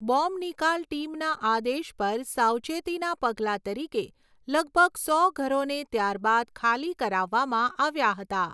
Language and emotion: Gujarati, neutral